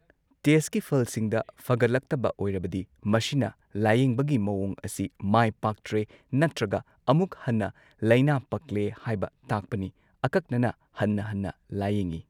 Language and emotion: Manipuri, neutral